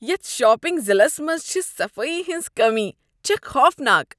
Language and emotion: Kashmiri, disgusted